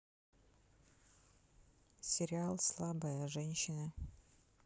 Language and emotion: Russian, neutral